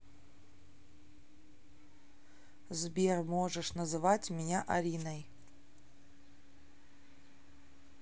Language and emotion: Russian, neutral